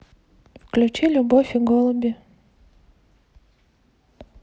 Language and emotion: Russian, neutral